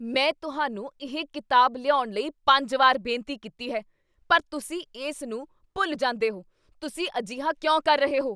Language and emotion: Punjabi, angry